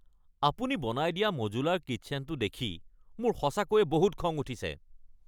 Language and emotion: Assamese, angry